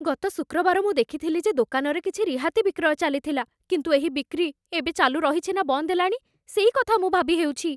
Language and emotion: Odia, fearful